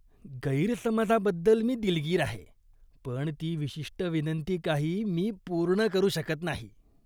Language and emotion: Marathi, disgusted